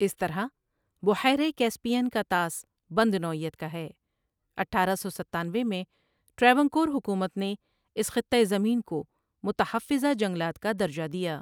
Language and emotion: Urdu, neutral